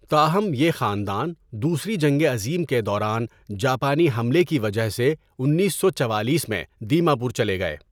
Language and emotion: Urdu, neutral